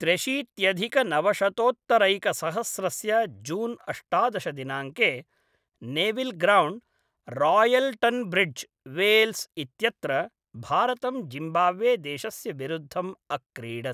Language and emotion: Sanskrit, neutral